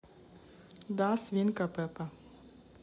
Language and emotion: Russian, neutral